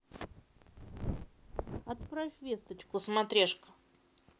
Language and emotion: Russian, neutral